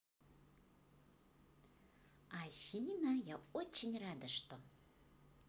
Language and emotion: Russian, positive